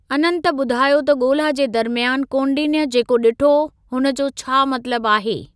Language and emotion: Sindhi, neutral